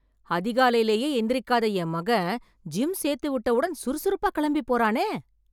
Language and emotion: Tamil, surprised